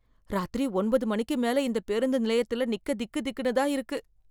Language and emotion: Tamil, fearful